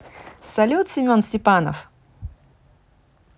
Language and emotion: Russian, positive